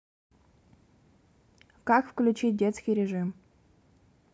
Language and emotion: Russian, neutral